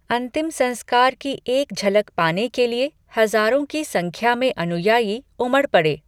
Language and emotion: Hindi, neutral